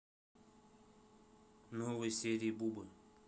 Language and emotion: Russian, neutral